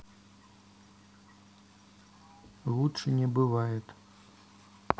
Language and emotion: Russian, neutral